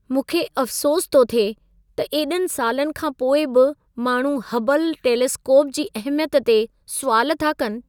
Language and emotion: Sindhi, sad